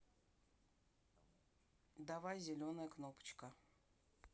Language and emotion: Russian, neutral